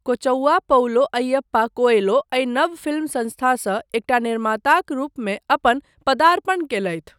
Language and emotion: Maithili, neutral